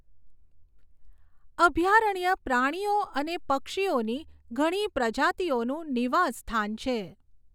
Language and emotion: Gujarati, neutral